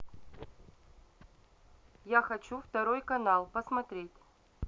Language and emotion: Russian, neutral